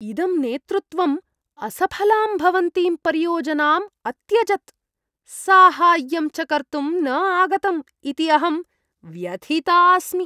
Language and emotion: Sanskrit, disgusted